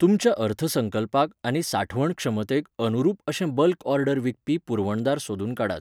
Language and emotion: Goan Konkani, neutral